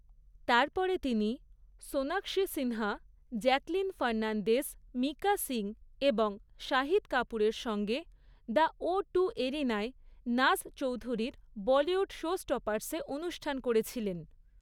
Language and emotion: Bengali, neutral